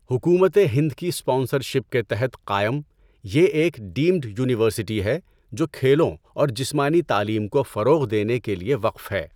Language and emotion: Urdu, neutral